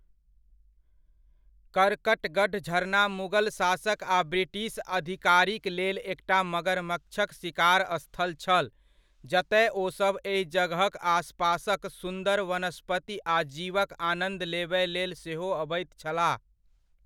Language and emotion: Maithili, neutral